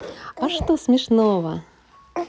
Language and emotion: Russian, positive